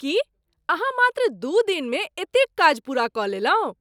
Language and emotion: Maithili, surprised